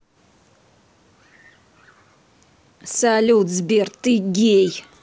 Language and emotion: Russian, angry